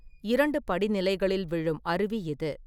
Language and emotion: Tamil, neutral